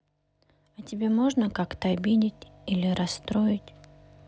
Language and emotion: Russian, sad